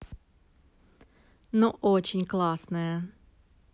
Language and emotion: Russian, positive